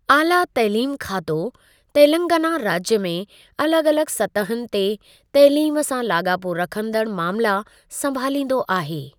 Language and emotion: Sindhi, neutral